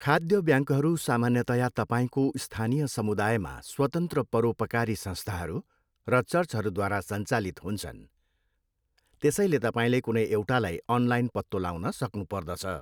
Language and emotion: Nepali, neutral